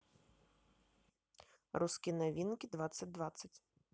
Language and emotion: Russian, neutral